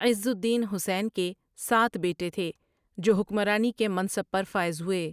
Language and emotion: Urdu, neutral